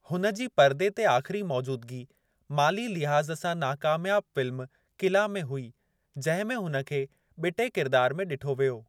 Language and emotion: Sindhi, neutral